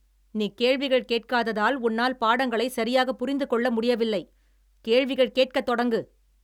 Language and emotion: Tamil, angry